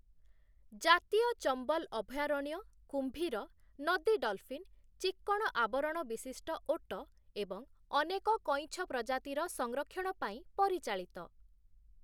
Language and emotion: Odia, neutral